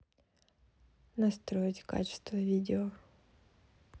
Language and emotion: Russian, neutral